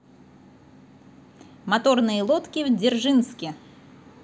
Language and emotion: Russian, positive